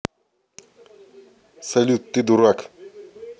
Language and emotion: Russian, neutral